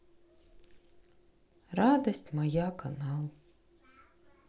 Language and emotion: Russian, sad